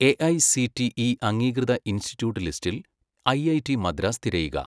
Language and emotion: Malayalam, neutral